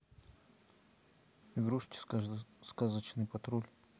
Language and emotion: Russian, neutral